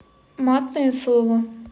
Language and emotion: Russian, neutral